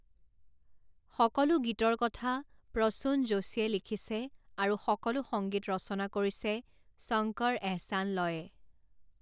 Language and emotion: Assamese, neutral